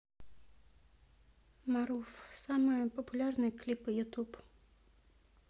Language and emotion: Russian, neutral